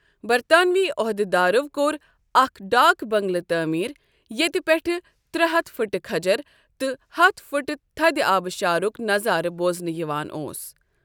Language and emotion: Kashmiri, neutral